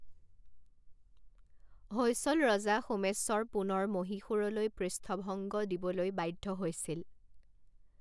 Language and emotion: Assamese, neutral